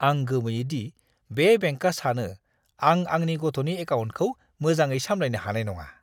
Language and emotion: Bodo, disgusted